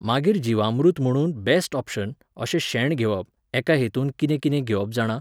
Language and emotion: Goan Konkani, neutral